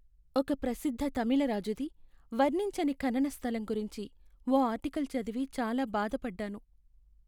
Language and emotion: Telugu, sad